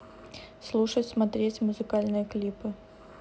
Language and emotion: Russian, neutral